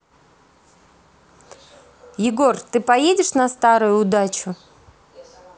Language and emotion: Russian, neutral